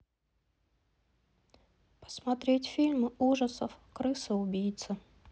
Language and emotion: Russian, sad